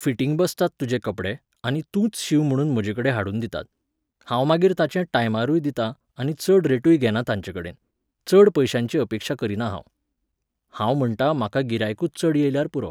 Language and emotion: Goan Konkani, neutral